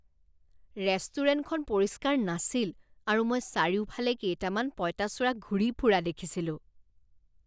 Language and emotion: Assamese, disgusted